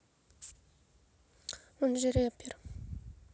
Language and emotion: Russian, neutral